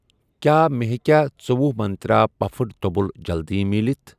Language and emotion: Kashmiri, neutral